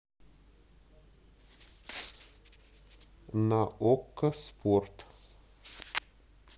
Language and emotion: Russian, neutral